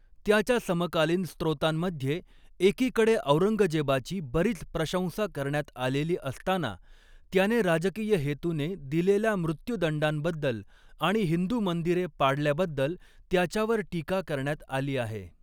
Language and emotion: Marathi, neutral